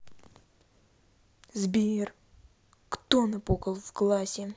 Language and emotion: Russian, angry